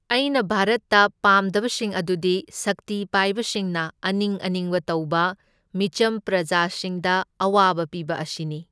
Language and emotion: Manipuri, neutral